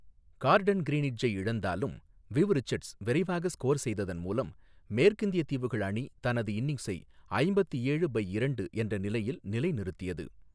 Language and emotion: Tamil, neutral